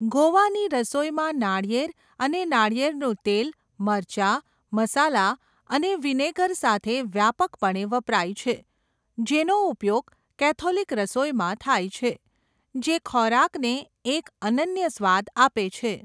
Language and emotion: Gujarati, neutral